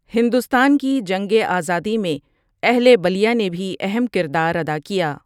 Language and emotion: Urdu, neutral